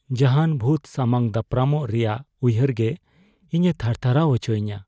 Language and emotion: Santali, fearful